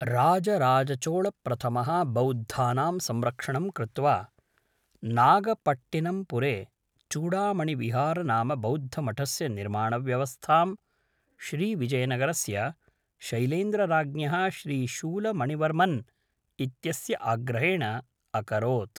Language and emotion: Sanskrit, neutral